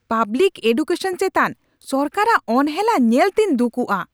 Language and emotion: Santali, angry